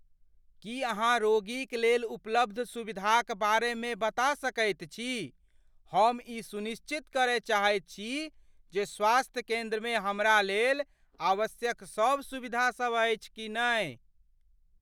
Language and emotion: Maithili, fearful